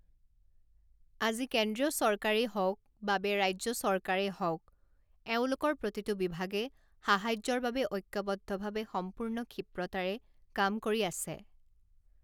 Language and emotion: Assamese, neutral